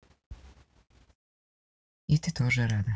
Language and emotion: Russian, neutral